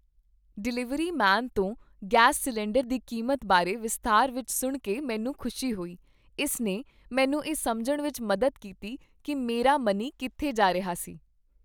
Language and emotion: Punjabi, happy